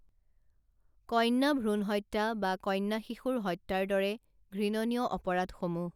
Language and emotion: Assamese, neutral